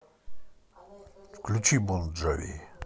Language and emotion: Russian, positive